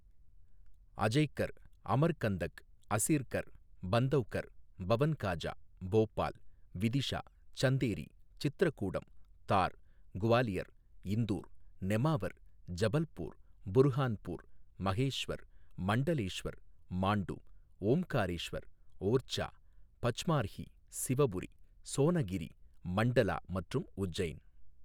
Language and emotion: Tamil, neutral